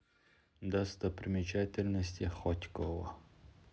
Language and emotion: Russian, neutral